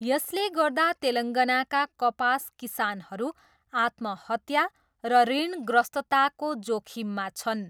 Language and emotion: Nepali, neutral